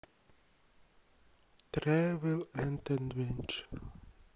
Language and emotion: Russian, sad